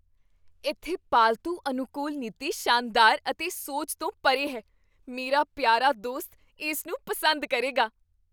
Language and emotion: Punjabi, surprised